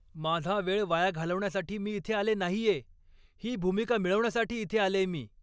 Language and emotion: Marathi, angry